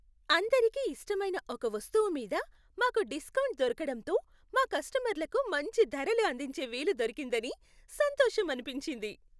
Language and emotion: Telugu, happy